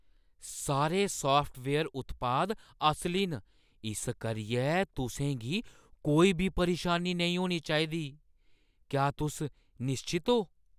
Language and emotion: Dogri, surprised